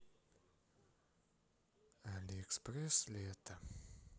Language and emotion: Russian, sad